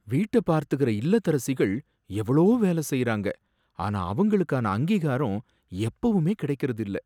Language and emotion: Tamil, sad